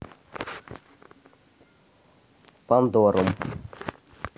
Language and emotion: Russian, neutral